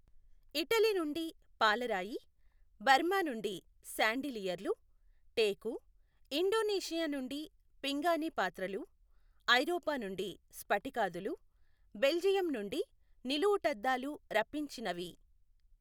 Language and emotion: Telugu, neutral